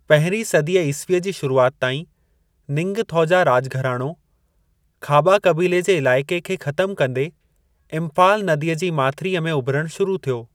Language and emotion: Sindhi, neutral